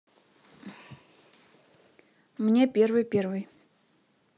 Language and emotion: Russian, neutral